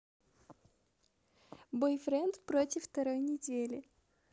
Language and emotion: Russian, positive